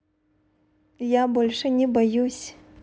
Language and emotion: Russian, positive